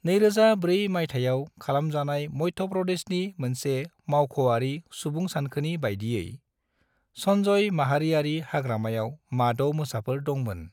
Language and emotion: Bodo, neutral